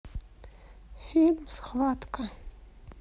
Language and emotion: Russian, neutral